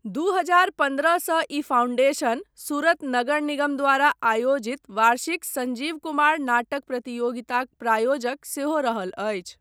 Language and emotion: Maithili, neutral